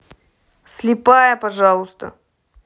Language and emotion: Russian, angry